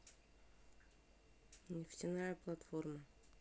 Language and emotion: Russian, neutral